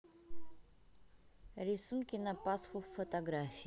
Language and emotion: Russian, neutral